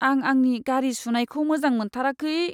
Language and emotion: Bodo, sad